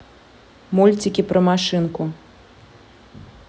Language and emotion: Russian, neutral